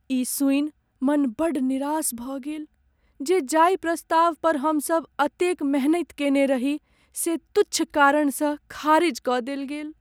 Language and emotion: Maithili, sad